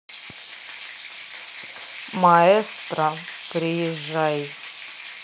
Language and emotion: Russian, neutral